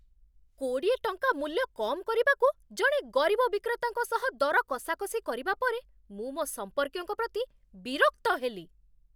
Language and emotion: Odia, angry